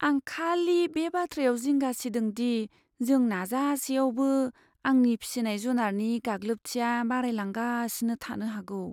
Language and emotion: Bodo, fearful